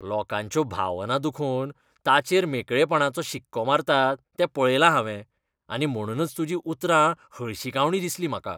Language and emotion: Goan Konkani, disgusted